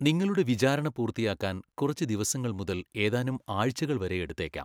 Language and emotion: Malayalam, neutral